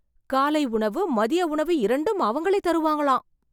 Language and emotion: Tamil, surprised